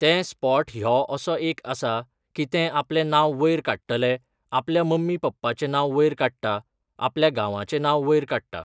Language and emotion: Goan Konkani, neutral